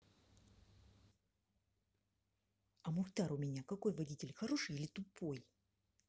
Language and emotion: Russian, neutral